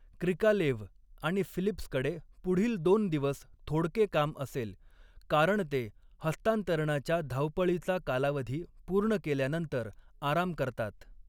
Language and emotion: Marathi, neutral